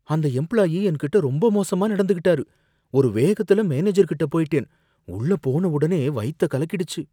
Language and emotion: Tamil, fearful